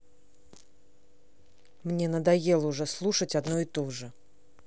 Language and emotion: Russian, angry